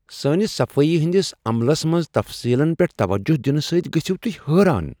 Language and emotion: Kashmiri, surprised